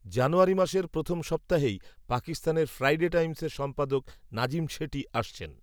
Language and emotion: Bengali, neutral